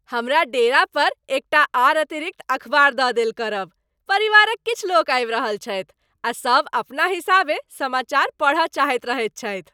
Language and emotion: Maithili, happy